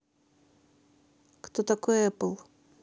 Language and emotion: Russian, neutral